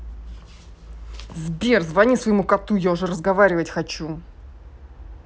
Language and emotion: Russian, angry